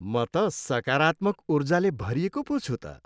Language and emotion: Nepali, happy